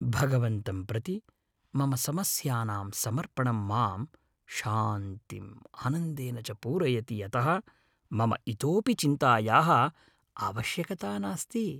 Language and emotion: Sanskrit, happy